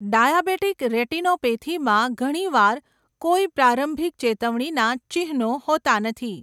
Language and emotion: Gujarati, neutral